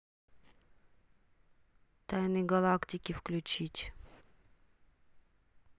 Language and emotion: Russian, neutral